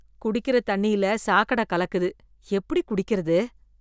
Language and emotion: Tamil, disgusted